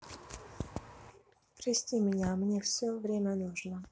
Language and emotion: Russian, neutral